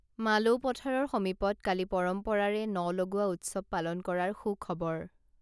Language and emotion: Assamese, neutral